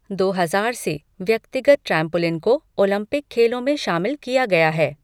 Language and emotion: Hindi, neutral